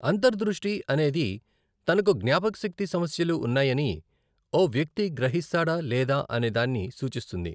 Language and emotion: Telugu, neutral